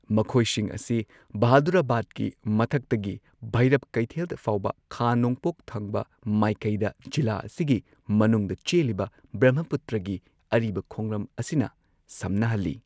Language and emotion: Manipuri, neutral